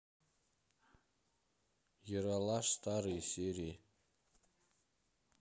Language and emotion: Russian, neutral